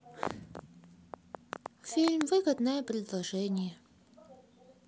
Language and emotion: Russian, sad